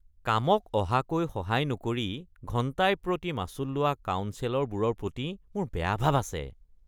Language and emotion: Assamese, disgusted